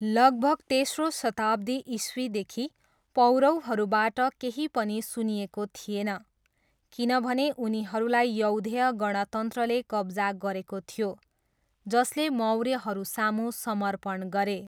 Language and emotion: Nepali, neutral